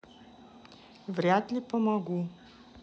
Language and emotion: Russian, neutral